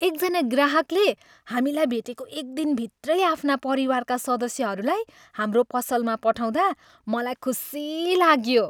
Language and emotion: Nepali, happy